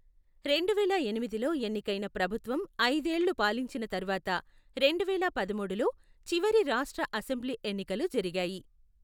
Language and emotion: Telugu, neutral